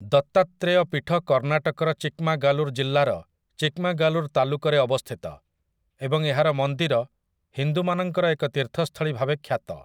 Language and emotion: Odia, neutral